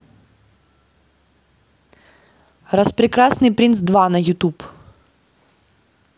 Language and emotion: Russian, neutral